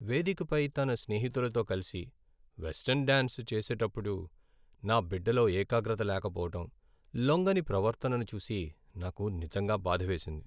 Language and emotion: Telugu, sad